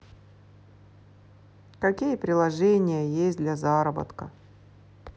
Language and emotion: Russian, neutral